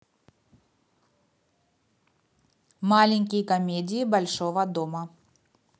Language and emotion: Russian, neutral